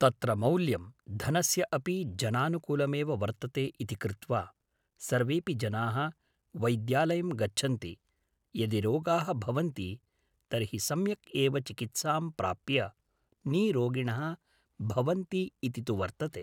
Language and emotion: Sanskrit, neutral